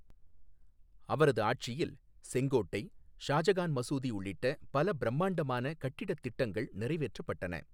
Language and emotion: Tamil, neutral